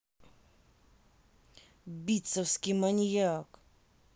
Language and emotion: Russian, angry